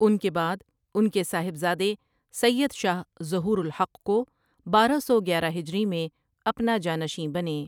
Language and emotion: Urdu, neutral